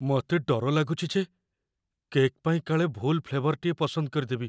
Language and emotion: Odia, fearful